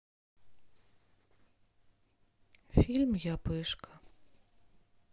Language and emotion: Russian, sad